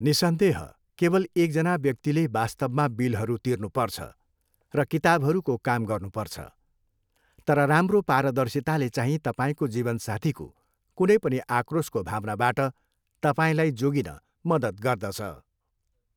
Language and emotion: Nepali, neutral